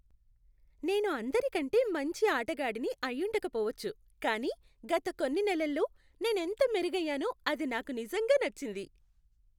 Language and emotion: Telugu, happy